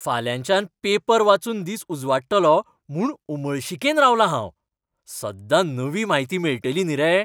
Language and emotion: Goan Konkani, happy